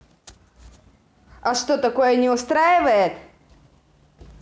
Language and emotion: Russian, angry